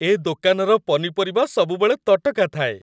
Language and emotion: Odia, happy